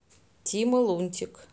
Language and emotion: Russian, neutral